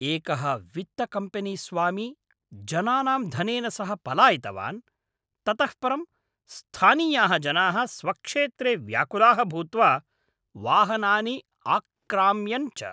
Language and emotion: Sanskrit, angry